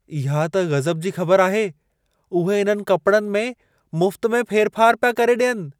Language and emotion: Sindhi, surprised